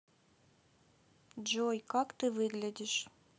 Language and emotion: Russian, neutral